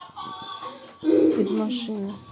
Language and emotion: Russian, neutral